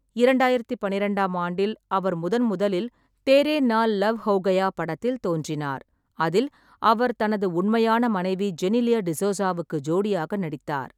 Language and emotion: Tamil, neutral